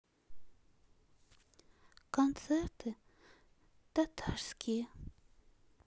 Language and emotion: Russian, sad